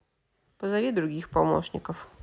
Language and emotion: Russian, neutral